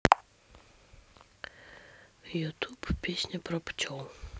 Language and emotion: Russian, neutral